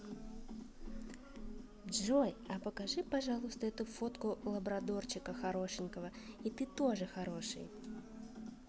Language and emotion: Russian, positive